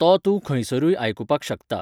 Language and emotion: Goan Konkani, neutral